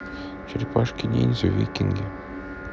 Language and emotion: Russian, neutral